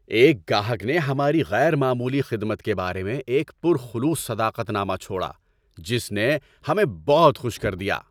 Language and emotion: Urdu, happy